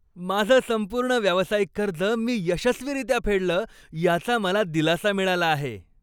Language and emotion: Marathi, happy